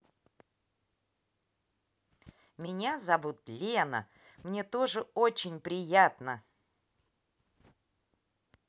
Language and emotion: Russian, positive